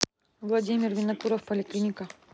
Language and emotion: Russian, neutral